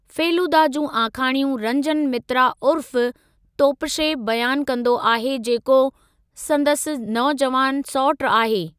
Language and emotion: Sindhi, neutral